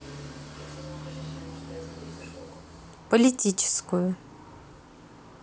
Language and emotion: Russian, neutral